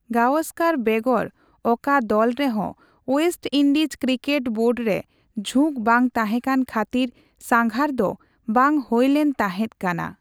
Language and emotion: Santali, neutral